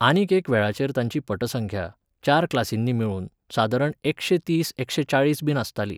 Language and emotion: Goan Konkani, neutral